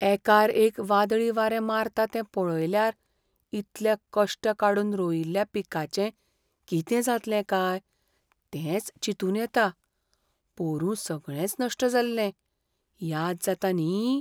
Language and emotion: Goan Konkani, fearful